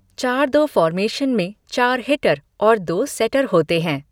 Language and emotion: Hindi, neutral